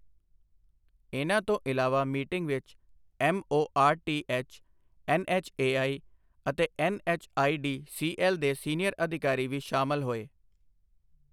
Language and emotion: Punjabi, neutral